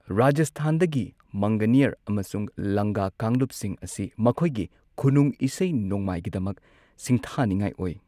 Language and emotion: Manipuri, neutral